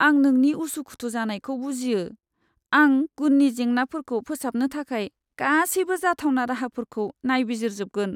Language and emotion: Bodo, sad